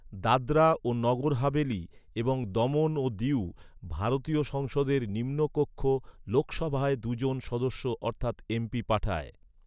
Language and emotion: Bengali, neutral